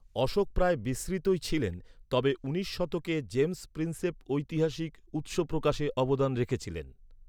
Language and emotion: Bengali, neutral